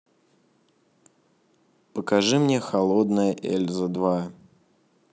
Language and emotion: Russian, neutral